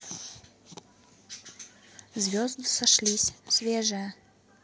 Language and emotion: Russian, neutral